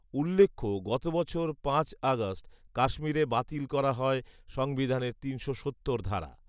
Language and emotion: Bengali, neutral